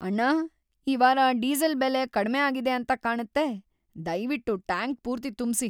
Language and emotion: Kannada, happy